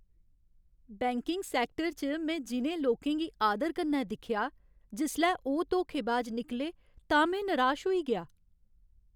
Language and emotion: Dogri, sad